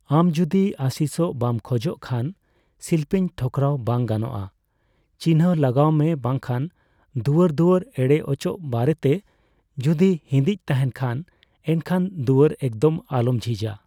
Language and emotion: Santali, neutral